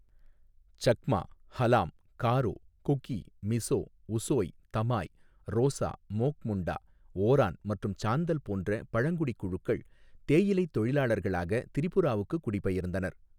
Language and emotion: Tamil, neutral